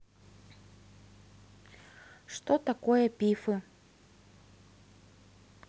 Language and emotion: Russian, neutral